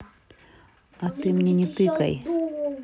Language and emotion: Russian, angry